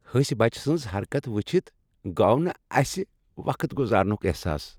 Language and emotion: Kashmiri, happy